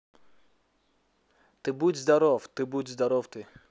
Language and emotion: Russian, neutral